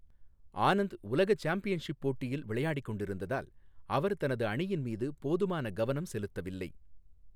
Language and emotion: Tamil, neutral